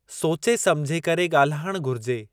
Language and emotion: Sindhi, neutral